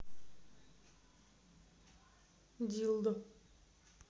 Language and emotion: Russian, neutral